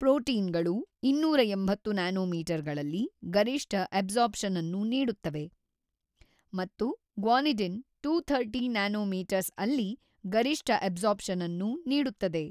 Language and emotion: Kannada, neutral